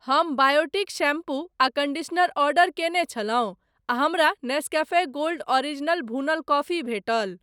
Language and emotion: Maithili, neutral